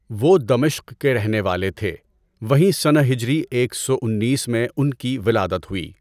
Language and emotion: Urdu, neutral